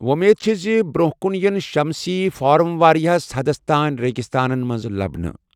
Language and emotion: Kashmiri, neutral